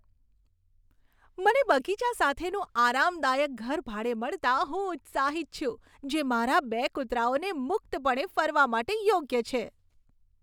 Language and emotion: Gujarati, happy